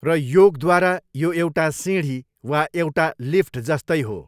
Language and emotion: Nepali, neutral